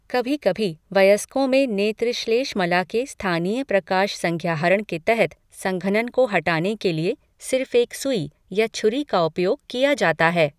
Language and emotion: Hindi, neutral